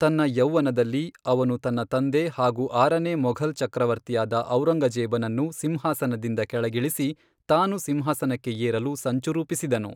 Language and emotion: Kannada, neutral